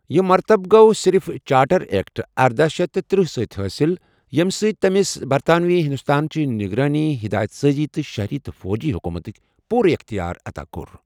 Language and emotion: Kashmiri, neutral